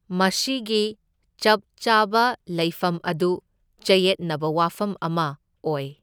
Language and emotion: Manipuri, neutral